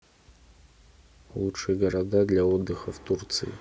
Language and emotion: Russian, neutral